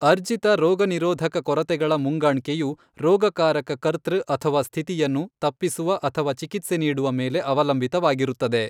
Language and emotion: Kannada, neutral